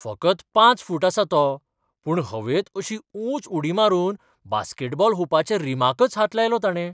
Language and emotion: Goan Konkani, surprised